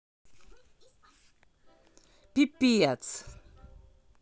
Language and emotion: Russian, angry